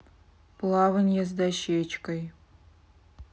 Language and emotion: Russian, neutral